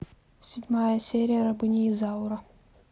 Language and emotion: Russian, neutral